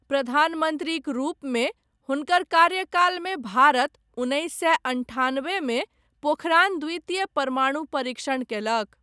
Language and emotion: Maithili, neutral